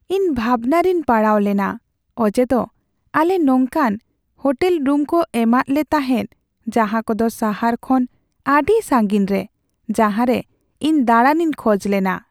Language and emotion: Santali, sad